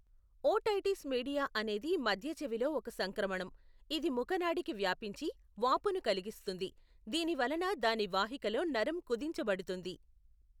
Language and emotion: Telugu, neutral